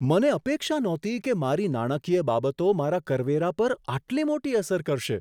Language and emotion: Gujarati, surprised